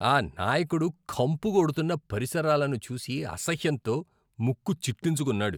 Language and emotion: Telugu, disgusted